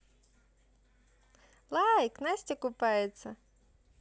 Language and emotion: Russian, positive